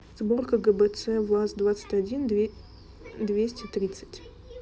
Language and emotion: Russian, neutral